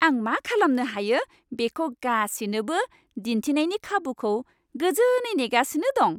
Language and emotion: Bodo, happy